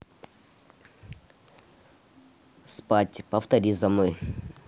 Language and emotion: Russian, neutral